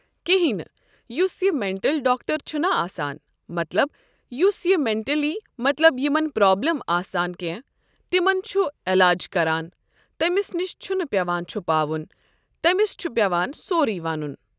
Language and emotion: Kashmiri, neutral